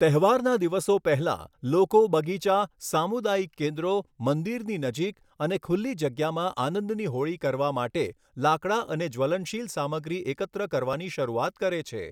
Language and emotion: Gujarati, neutral